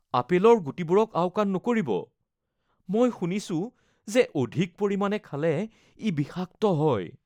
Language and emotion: Assamese, fearful